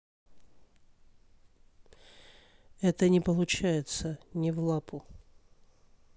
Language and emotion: Russian, sad